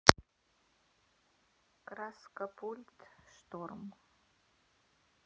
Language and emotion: Russian, neutral